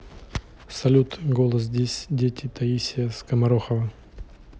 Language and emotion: Russian, neutral